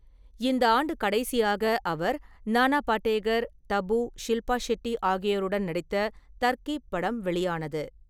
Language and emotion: Tamil, neutral